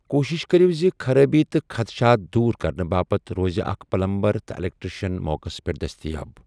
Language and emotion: Kashmiri, neutral